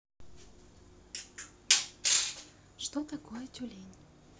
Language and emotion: Russian, neutral